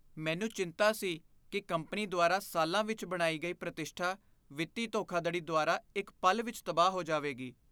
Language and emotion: Punjabi, fearful